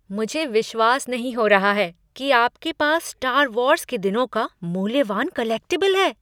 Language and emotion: Hindi, surprised